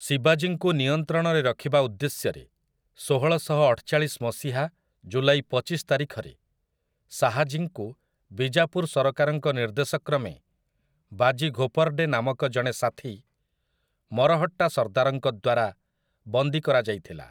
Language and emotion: Odia, neutral